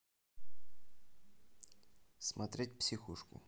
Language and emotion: Russian, neutral